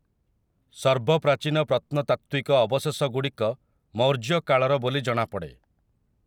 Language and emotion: Odia, neutral